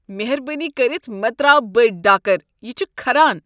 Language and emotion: Kashmiri, disgusted